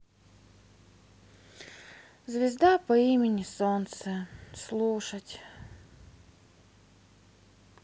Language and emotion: Russian, sad